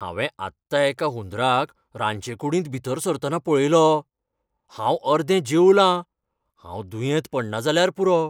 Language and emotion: Goan Konkani, fearful